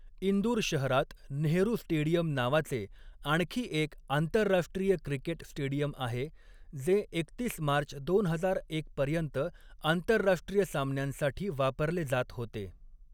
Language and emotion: Marathi, neutral